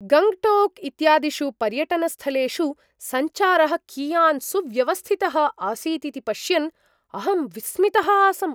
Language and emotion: Sanskrit, surprised